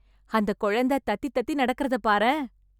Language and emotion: Tamil, happy